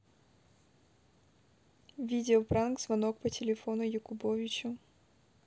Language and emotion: Russian, neutral